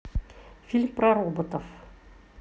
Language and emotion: Russian, neutral